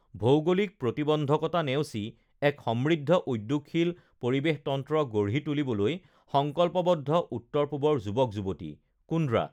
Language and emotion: Assamese, neutral